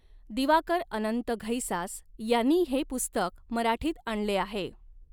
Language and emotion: Marathi, neutral